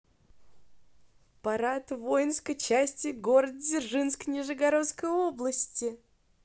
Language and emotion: Russian, positive